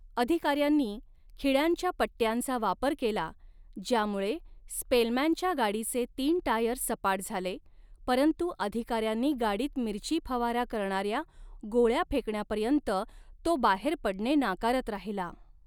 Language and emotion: Marathi, neutral